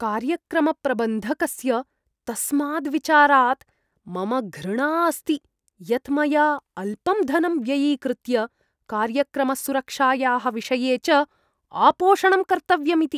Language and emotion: Sanskrit, disgusted